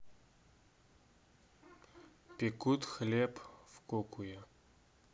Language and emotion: Russian, neutral